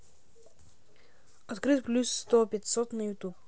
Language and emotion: Russian, neutral